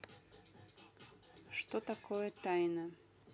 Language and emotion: Russian, neutral